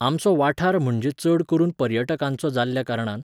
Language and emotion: Goan Konkani, neutral